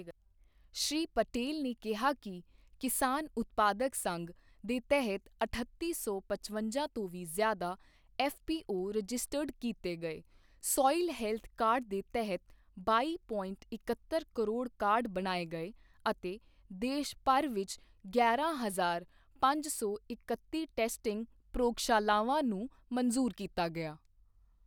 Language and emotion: Punjabi, neutral